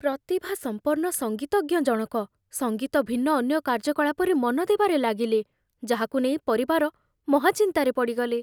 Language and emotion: Odia, fearful